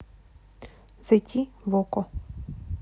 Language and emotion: Russian, neutral